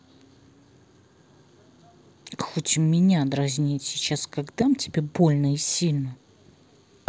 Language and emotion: Russian, angry